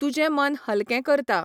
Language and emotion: Goan Konkani, neutral